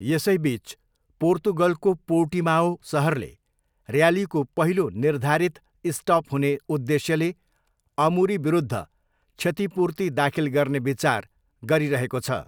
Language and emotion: Nepali, neutral